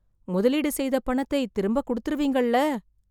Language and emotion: Tamil, fearful